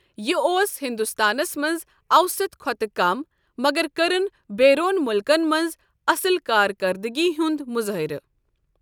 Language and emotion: Kashmiri, neutral